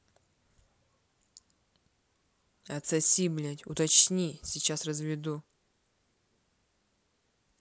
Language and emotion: Russian, angry